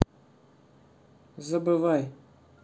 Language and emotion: Russian, neutral